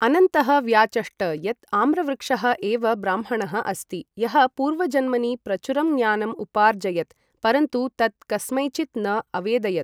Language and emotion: Sanskrit, neutral